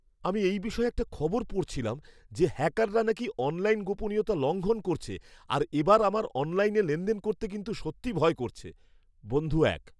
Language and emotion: Bengali, fearful